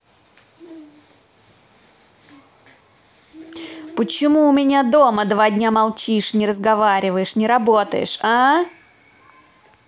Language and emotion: Russian, angry